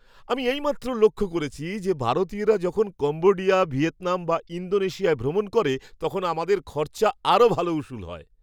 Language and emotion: Bengali, happy